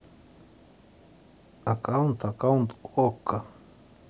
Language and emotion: Russian, neutral